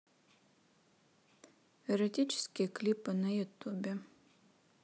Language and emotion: Russian, neutral